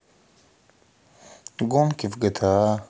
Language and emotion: Russian, sad